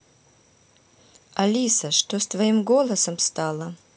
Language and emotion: Russian, neutral